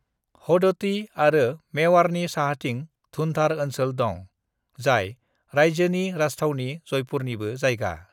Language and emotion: Bodo, neutral